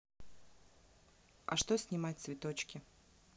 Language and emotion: Russian, neutral